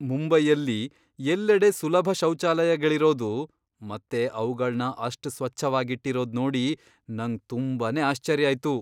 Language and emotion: Kannada, surprised